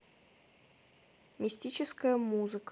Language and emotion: Russian, neutral